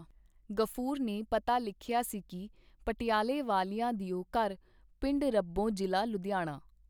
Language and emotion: Punjabi, neutral